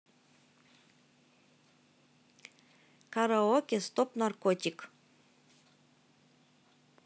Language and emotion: Russian, neutral